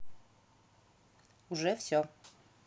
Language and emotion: Russian, neutral